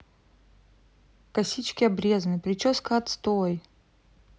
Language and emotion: Russian, sad